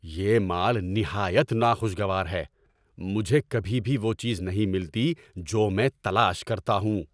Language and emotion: Urdu, angry